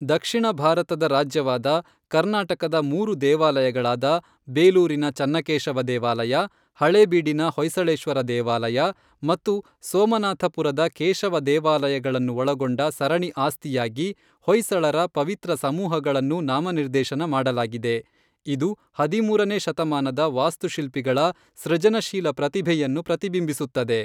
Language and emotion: Kannada, neutral